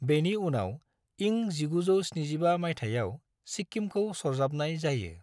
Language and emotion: Bodo, neutral